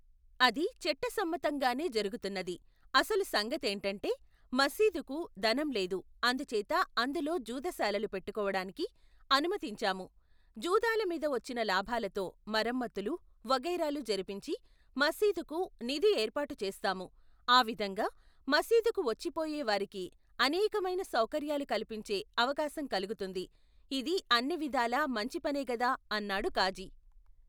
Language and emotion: Telugu, neutral